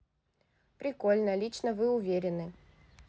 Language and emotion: Russian, positive